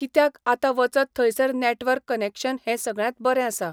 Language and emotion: Goan Konkani, neutral